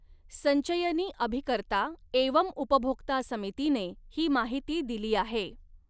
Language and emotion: Marathi, neutral